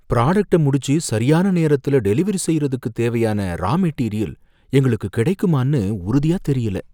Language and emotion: Tamil, fearful